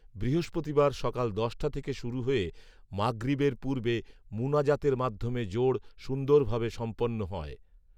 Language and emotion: Bengali, neutral